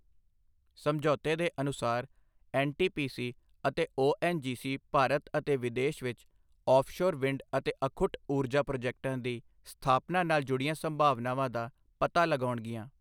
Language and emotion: Punjabi, neutral